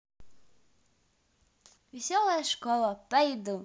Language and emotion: Russian, positive